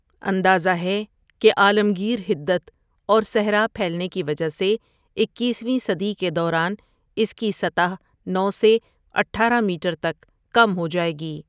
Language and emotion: Urdu, neutral